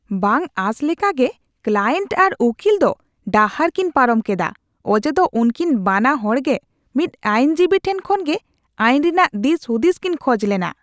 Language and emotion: Santali, disgusted